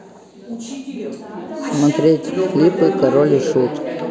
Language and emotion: Russian, neutral